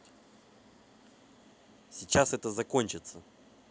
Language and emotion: Russian, neutral